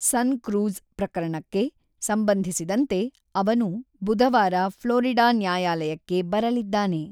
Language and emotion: Kannada, neutral